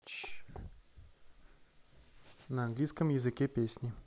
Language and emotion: Russian, neutral